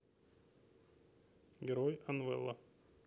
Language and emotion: Russian, neutral